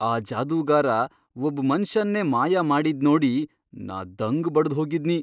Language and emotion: Kannada, surprised